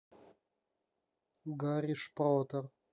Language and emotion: Russian, neutral